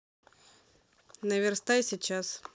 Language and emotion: Russian, neutral